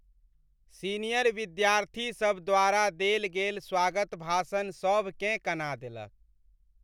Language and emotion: Maithili, sad